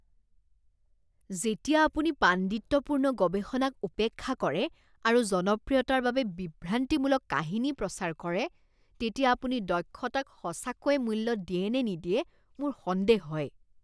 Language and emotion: Assamese, disgusted